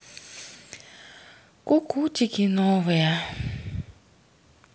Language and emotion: Russian, sad